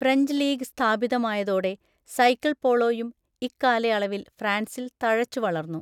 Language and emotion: Malayalam, neutral